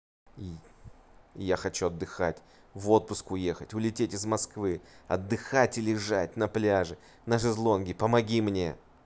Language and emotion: Russian, angry